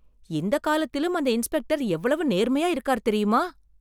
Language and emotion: Tamil, surprised